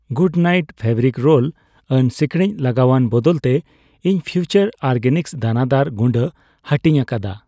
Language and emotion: Santali, neutral